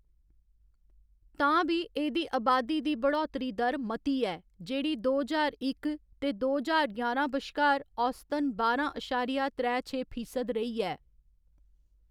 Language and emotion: Dogri, neutral